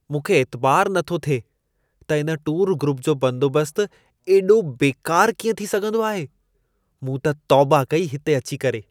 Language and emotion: Sindhi, disgusted